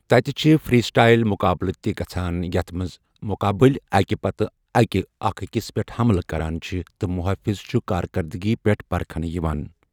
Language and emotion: Kashmiri, neutral